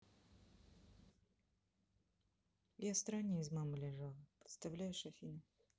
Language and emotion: Russian, sad